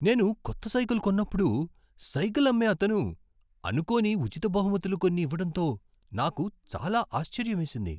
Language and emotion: Telugu, surprised